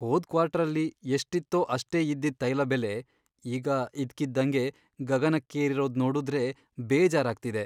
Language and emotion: Kannada, sad